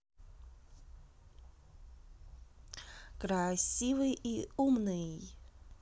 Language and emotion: Russian, positive